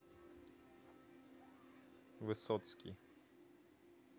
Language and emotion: Russian, neutral